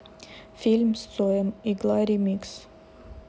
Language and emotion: Russian, neutral